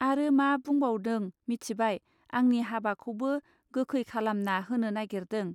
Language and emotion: Bodo, neutral